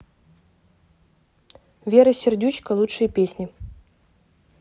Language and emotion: Russian, neutral